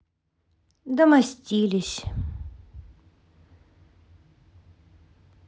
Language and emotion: Russian, sad